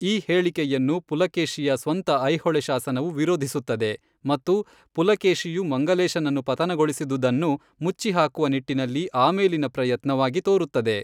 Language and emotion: Kannada, neutral